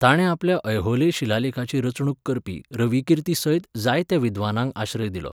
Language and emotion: Goan Konkani, neutral